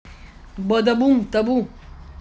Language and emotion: Russian, positive